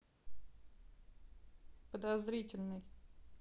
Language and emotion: Russian, neutral